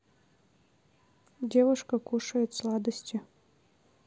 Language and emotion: Russian, neutral